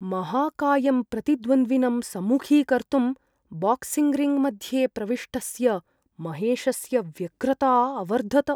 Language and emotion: Sanskrit, fearful